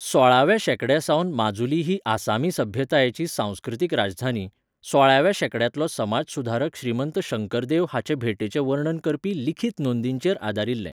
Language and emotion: Goan Konkani, neutral